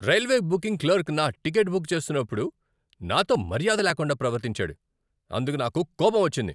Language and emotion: Telugu, angry